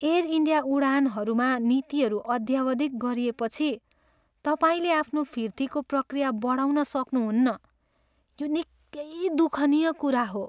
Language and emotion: Nepali, sad